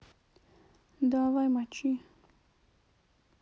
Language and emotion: Russian, sad